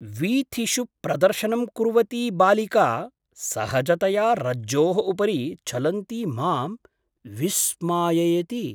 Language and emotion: Sanskrit, surprised